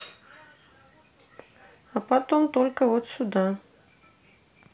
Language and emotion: Russian, neutral